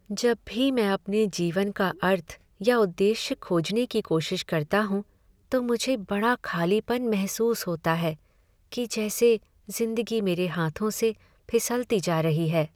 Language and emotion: Hindi, sad